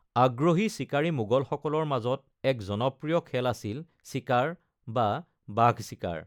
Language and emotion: Assamese, neutral